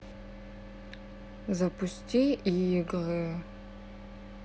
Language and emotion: Russian, neutral